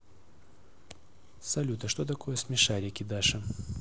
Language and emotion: Russian, neutral